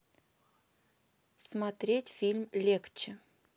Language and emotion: Russian, neutral